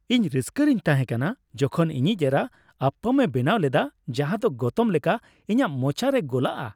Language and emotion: Santali, happy